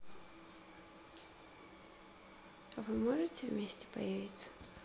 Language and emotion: Russian, neutral